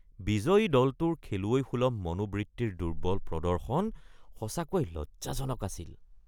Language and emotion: Assamese, disgusted